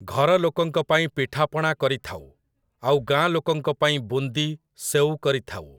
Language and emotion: Odia, neutral